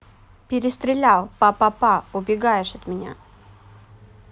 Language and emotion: Russian, neutral